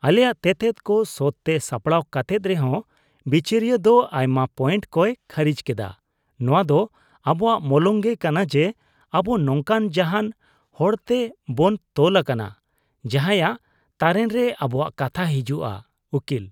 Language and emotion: Santali, disgusted